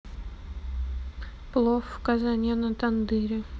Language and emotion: Russian, neutral